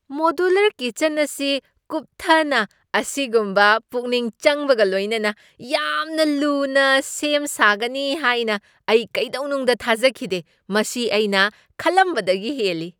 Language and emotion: Manipuri, surprised